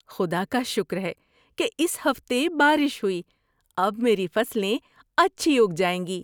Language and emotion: Urdu, happy